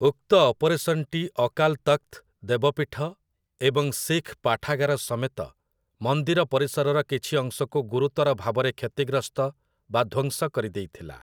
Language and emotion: Odia, neutral